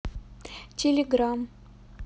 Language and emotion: Russian, neutral